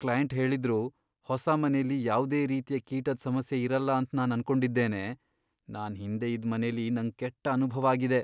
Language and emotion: Kannada, fearful